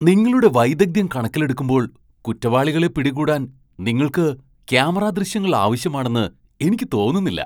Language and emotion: Malayalam, surprised